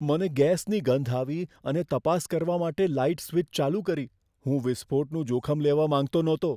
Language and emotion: Gujarati, fearful